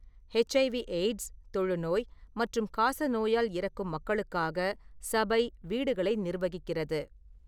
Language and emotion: Tamil, neutral